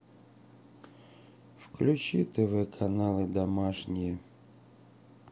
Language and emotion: Russian, sad